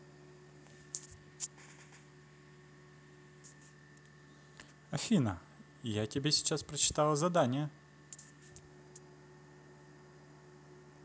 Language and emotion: Russian, positive